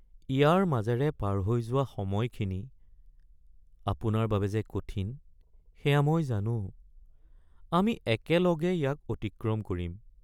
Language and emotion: Assamese, sad